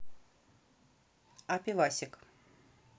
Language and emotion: Russian, neutral